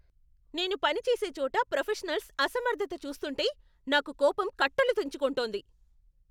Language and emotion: Telugu, angry